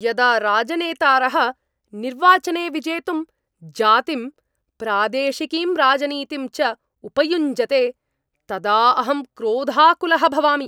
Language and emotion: Sanskrit, angry